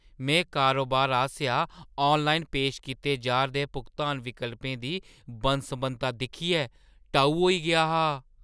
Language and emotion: Dogri, surprised